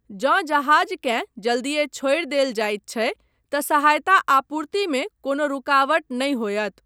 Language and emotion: Maithili, neutral